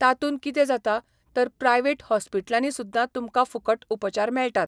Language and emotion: Goan Konkani, neutral